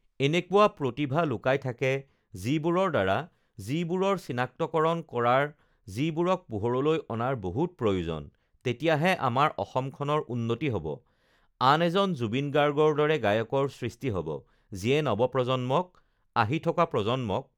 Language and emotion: Assamese, neutral